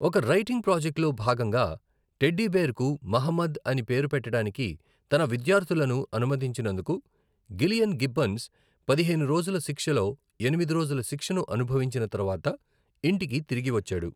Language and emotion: Telugu, neutral